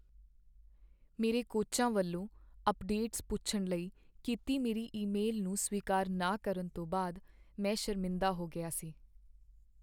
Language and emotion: Punjabi, sad